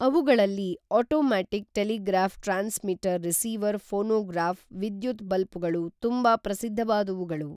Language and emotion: Kannada, neutral